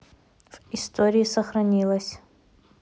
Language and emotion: Russian, neutral